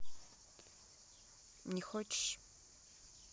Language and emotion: Russian, neutral